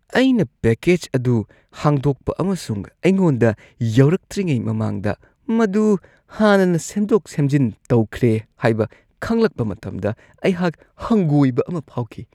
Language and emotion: Manipuri, disgusted